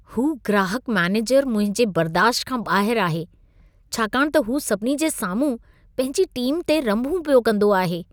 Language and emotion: Sindhi, disgusted